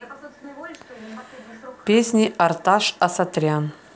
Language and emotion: Russian, neutral